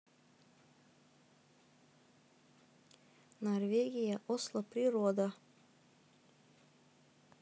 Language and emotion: Russian, neutral